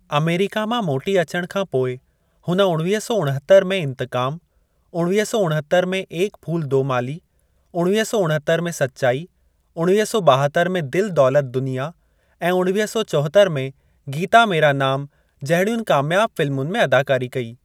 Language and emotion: Sindhi, neutral